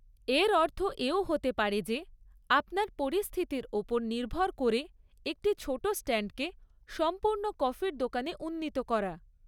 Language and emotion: Bengali, neutral